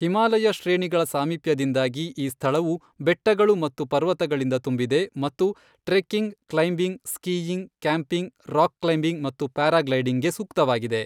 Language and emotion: Kannada, neutral